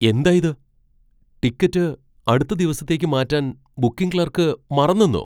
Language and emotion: Malayalam, surprised